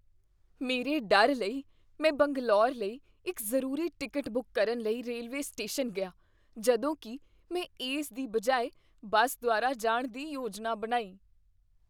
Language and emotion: Punjabi, fearful